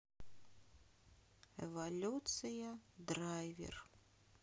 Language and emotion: Russian, sad